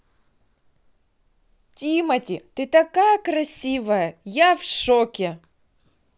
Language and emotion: Russian, positive